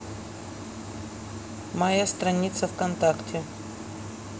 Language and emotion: Russian, neutral